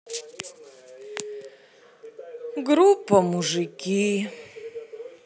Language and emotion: Russian, sad